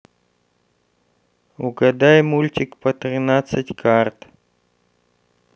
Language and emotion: Russian, neutral